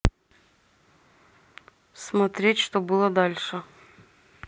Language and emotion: Russian, neutral